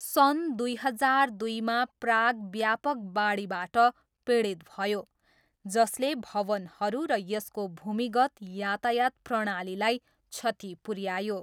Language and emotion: Nepali, neutral